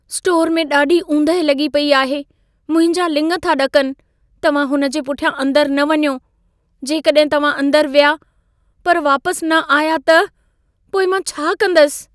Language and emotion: Sindhi, fearful